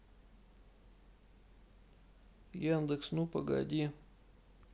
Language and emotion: Russian, sad